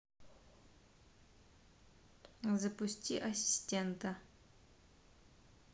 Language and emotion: Russian, neutral